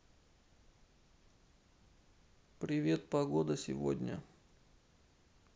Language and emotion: Russian, neutral